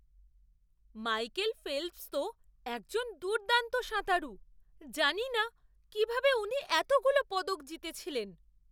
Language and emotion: Bengali, surprised